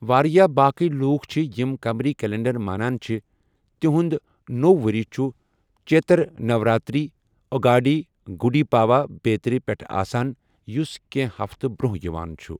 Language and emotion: Kashmiri, neutral